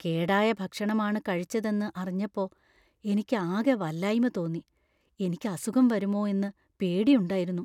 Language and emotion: Malayalam, fearful